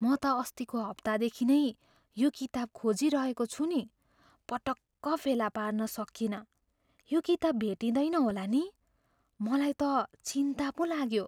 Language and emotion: Nepali, fearful